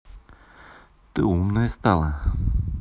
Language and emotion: Russian, neutral